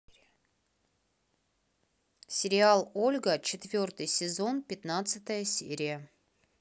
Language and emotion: Russian, neutral